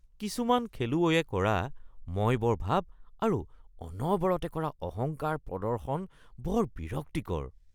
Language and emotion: Assamese, disgusted